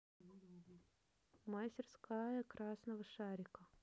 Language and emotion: Russian, neutral